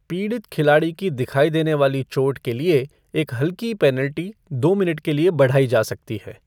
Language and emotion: Hindi, neutral